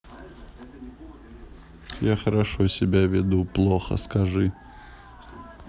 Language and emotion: Russian, neutral